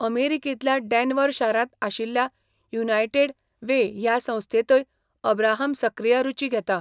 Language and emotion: Goan Konkani, neutral